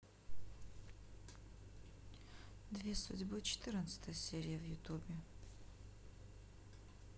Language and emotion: Russian, neutral